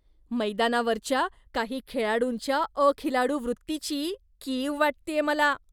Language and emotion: Marathi, disgusted